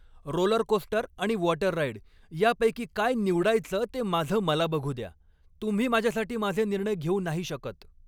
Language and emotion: Marathi, angry